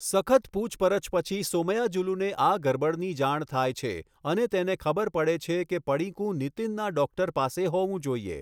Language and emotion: Gujarati, neutral